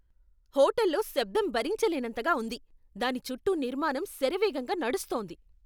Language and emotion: Telugu, angry